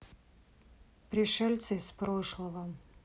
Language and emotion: Russian, sad